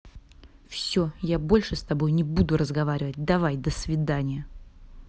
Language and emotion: Russian, angry